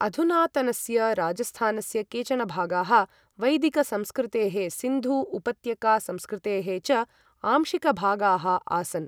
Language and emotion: Sanskrit, neutral